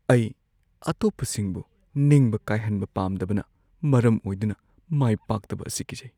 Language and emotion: Manipuri, fearful